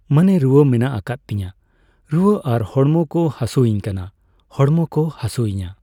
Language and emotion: Santali, neutral